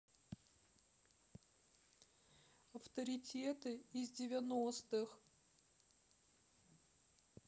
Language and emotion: Russian, sad